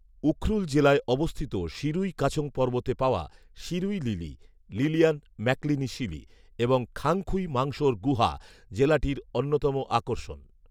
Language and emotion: Bengali, neutral